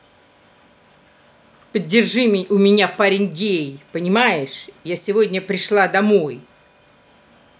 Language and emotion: Russian, angry